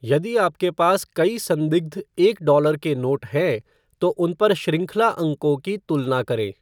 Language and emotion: Hindi, neutral